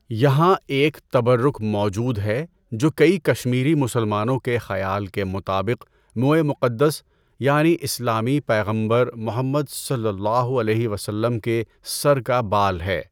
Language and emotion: Urdu, neutral